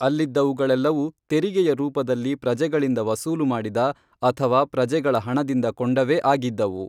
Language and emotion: Kannada, neutral